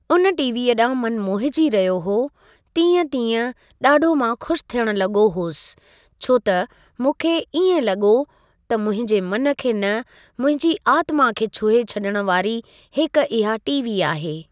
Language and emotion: Sindhi, neutral